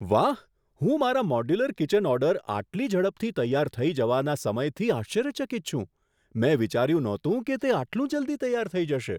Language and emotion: Gujarati, surprised